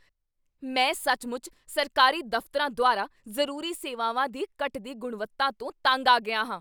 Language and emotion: Punjabi, angry